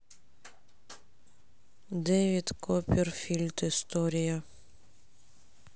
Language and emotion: Russian, sad